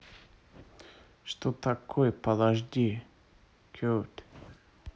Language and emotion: Russian, neutral